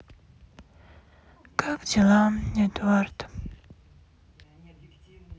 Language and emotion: Russian, sad